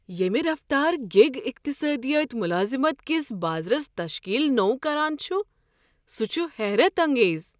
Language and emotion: Kashmiri, surprised